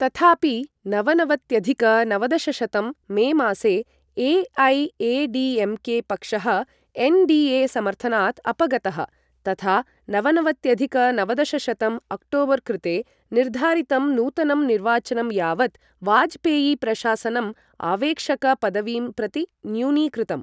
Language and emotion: Sanskrit, neutral